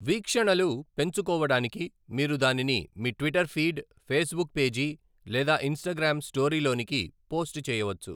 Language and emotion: Telugu, neutral